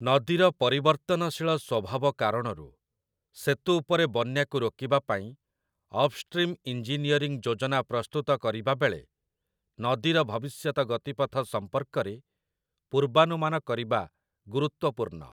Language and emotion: Odia, neutral